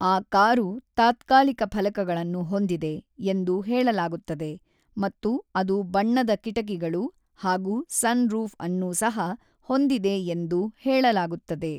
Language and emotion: Kannada, neutral